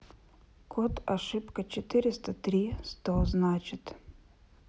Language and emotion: Russian, neutral